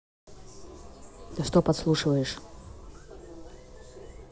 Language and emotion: Russian, angry